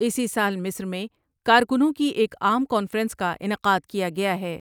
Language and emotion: Urdu, neutral